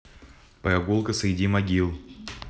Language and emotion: Russian, neutral